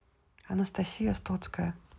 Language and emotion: Russian, neutral